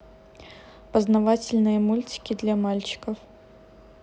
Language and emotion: Russian, neutral